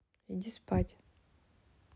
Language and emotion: Russian, neutral